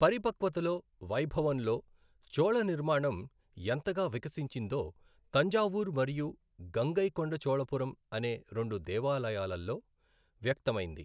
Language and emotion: Telugu, neutral